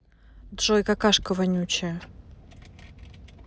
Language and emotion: Russian, angry